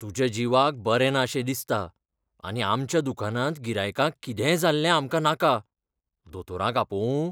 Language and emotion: Goan Konkani, fearful